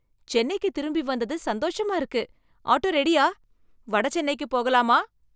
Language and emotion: Tamil, happy